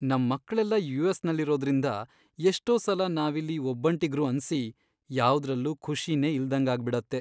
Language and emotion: Kannada, sad